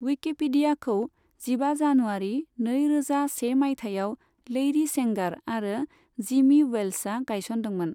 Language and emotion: Bodo, neutral